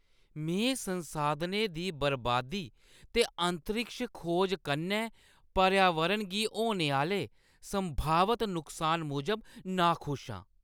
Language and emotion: Dogri, disgusted